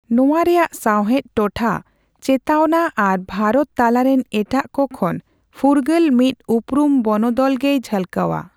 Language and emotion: Santali, neutral